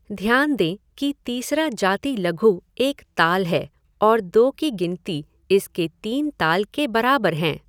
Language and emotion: Hindi, neutral